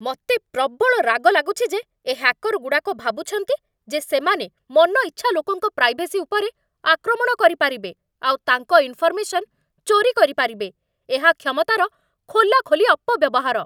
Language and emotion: Odia, angry